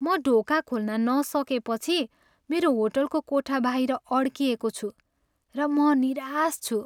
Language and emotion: Nepali, sad